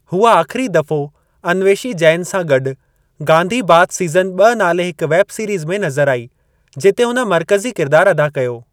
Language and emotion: Sindhi, neutral